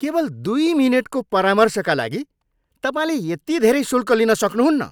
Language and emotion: Nepali, angry